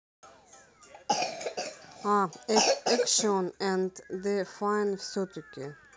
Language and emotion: Russian, neutral